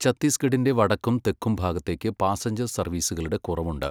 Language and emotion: Malayalam, neutral